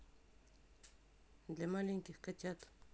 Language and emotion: Russian, neutral